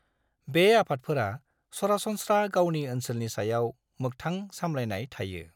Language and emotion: Bodo, neutral